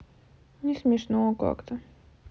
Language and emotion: Russian, sad